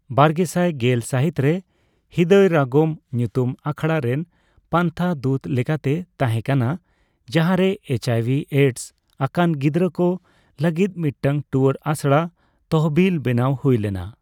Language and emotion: Santali, neutral